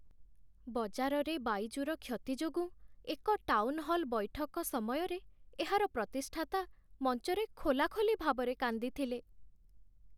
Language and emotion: Odia, sad